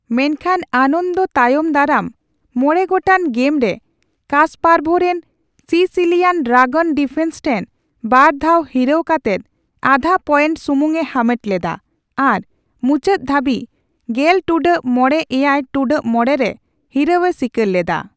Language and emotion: Santali, neutral